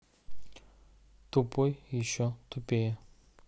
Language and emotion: Russian, neutral